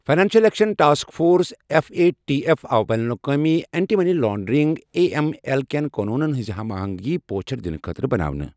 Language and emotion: Kashmiri, neutral